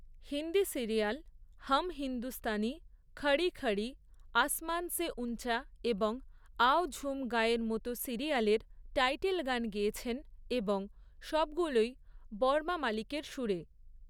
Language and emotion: Bengali, neutral